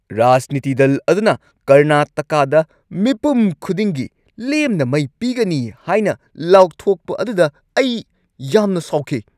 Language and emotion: Manipuri, angry